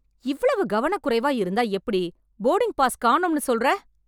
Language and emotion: Tamil, angry